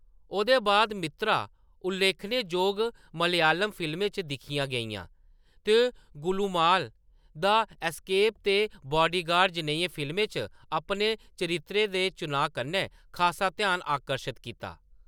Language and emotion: Dogri, neutral